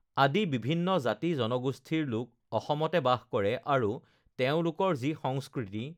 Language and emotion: Assamese, neutral